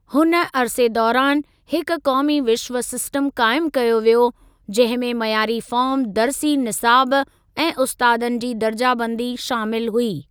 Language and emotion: Sindhi, neutral